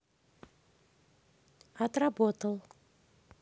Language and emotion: Russian, neutral